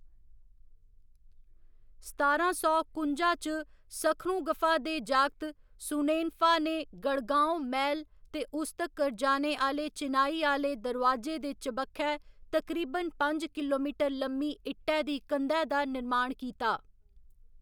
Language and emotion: Dogri, neutral